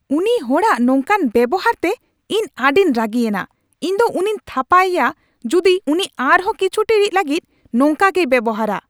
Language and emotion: Santali, angry